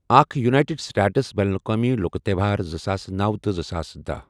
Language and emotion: Kashmiri, neutral